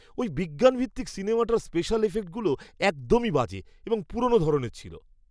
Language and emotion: Bengali, disgusted